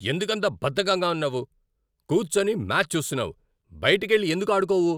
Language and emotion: Telugu, angry